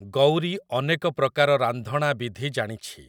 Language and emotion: Odia, neutral